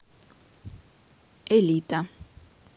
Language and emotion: Russian, neutral